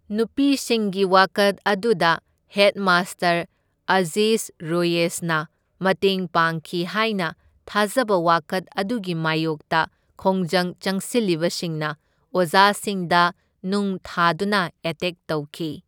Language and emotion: Manipuri, neutral